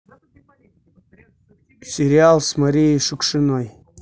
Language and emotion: Russian, neutral